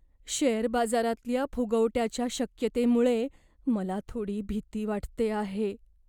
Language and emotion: Marathi, fearful